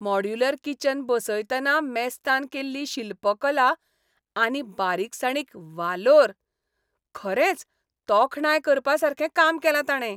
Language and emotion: Goan Konkani, happy